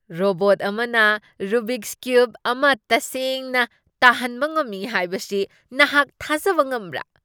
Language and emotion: Manipuri, surprised